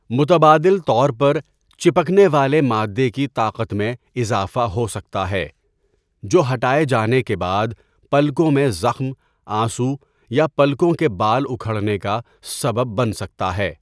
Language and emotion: Urdu, neutral